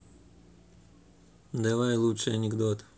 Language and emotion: Russian, neutral